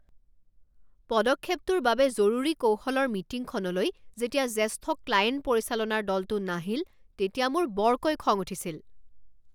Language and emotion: Assamese, angry